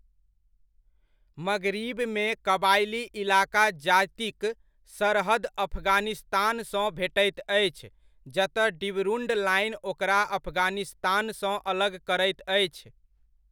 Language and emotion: Maithili, neutral